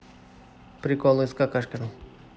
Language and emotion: Russian, neutral